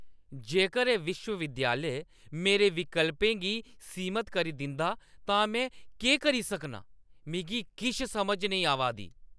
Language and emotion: Dogri, angry